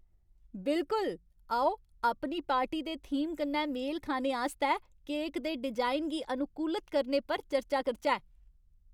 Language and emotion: Dogri, happy